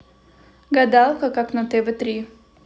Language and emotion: Russian, neutral